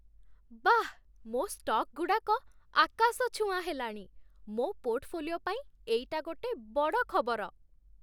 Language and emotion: Odia, happy